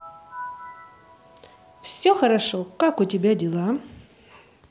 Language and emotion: Russian, positive